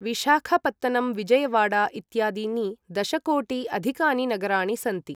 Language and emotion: Sanskrit, neutral